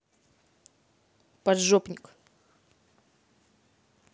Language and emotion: Russian, angry